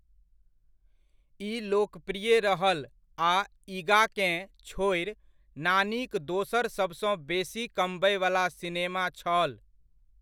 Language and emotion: Maithili, neutral